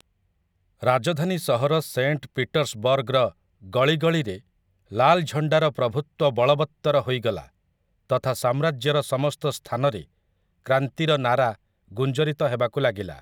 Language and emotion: Odia, neutral